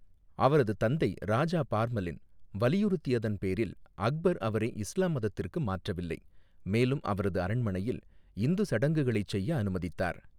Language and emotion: Tamil, neutral